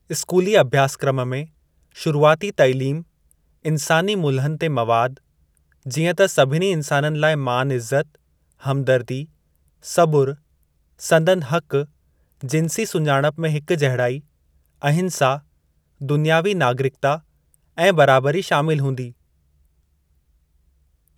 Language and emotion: Sindhi, neutral